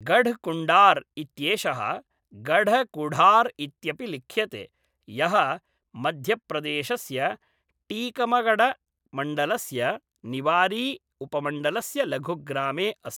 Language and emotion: Sanskrit, neutral